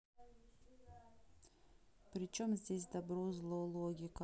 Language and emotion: Russian, neutral